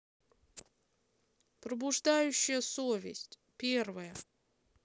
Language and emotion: Russian, neutral